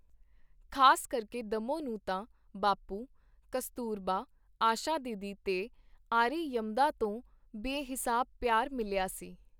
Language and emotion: Punjabi, neutral